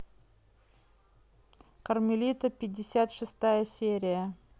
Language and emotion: Russian, neutral